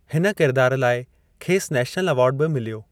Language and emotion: Sindhi, neutral